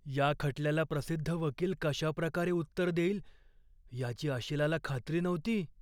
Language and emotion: Marathi, fearful